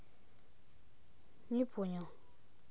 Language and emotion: Russian, neutral